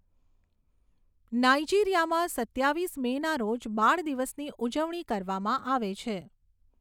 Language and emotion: Gujarati, neutral